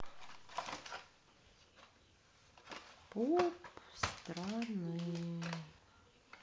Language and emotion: Russian, sad